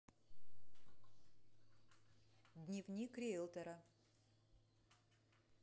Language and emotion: Russian, neutral